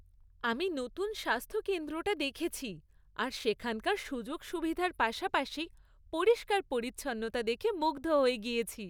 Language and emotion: Bengali, happy